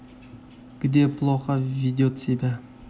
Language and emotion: Russian, neutral